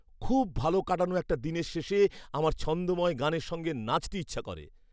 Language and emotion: Bengali, happy